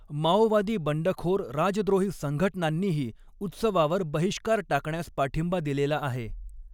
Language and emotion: Marathi, neutral